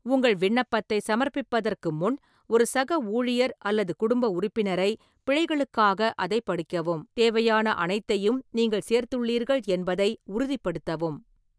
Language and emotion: Tamil, neutral